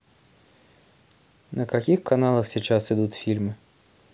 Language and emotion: Russian, neutral